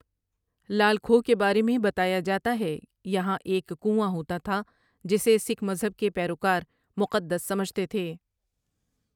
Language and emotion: Urdu, neutral